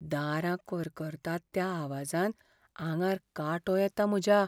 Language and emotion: Goan Konkani, fearful